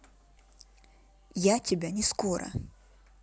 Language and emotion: Russian, neutral